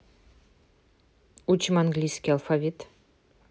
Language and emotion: Russian, neutral